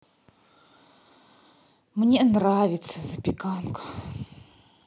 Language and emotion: Russian, sad